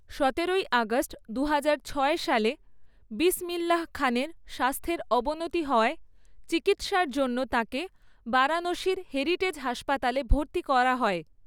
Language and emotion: Bengali, neutral